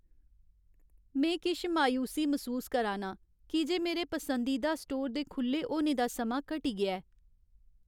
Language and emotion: Dogri, sad